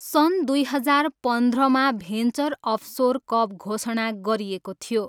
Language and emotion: Nepali, neutral